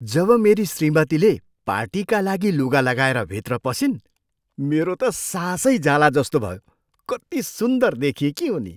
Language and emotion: Nepali, surprised